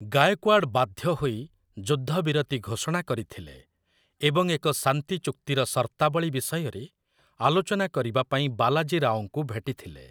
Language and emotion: Odia, neutral